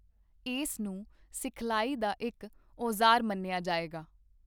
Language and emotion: Punjabi, neutral